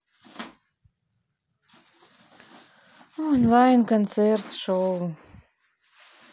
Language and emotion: Russian, sad